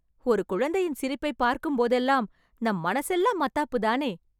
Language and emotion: Tamil, happy